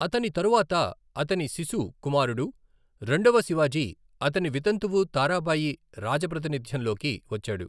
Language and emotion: Telugu, neutral